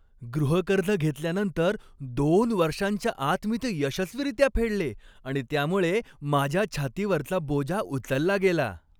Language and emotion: Marathi, happy